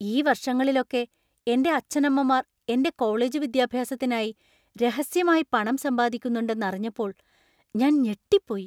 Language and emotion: Malayalam, surprised